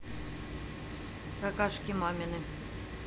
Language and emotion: Russian, neutral